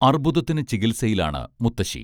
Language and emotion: Malayalam, neutral